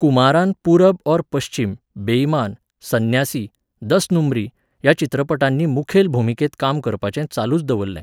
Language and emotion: Goan Konkani, neutral